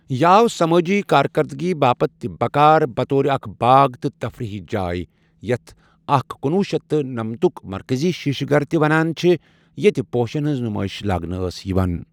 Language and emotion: Kashmiri, neutral